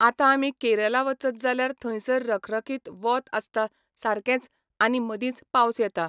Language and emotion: Goan Konkani, neutral